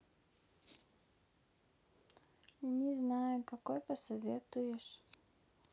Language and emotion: Russian, sad